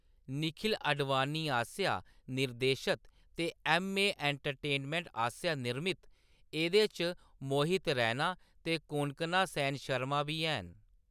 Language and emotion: Dogri, neutral